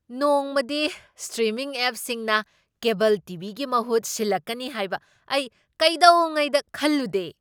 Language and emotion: Manipuri, surprised